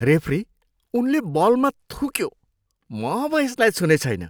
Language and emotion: Nepali, disgusted